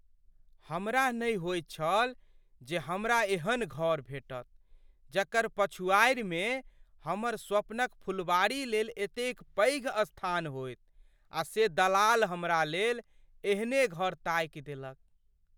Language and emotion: Maithili, surprised